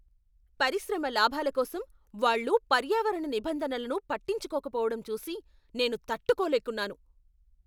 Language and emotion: Telugu, angry